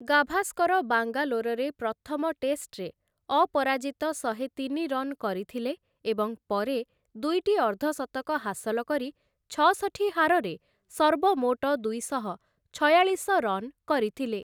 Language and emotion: Odia, neutral